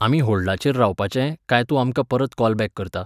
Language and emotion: Goan Konkani, neutral